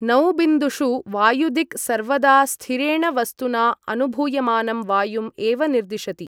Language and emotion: Sanskrit, neutral